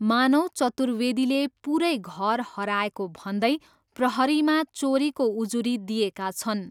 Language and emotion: Nepali, neutral